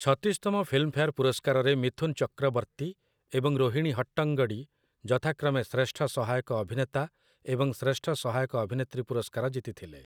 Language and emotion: Odia, neutral